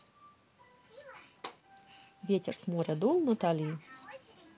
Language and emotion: Russian, neutral